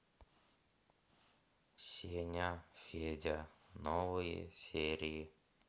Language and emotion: Russian, sad